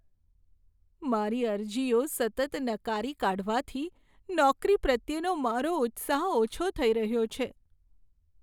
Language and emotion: Gujarati, sad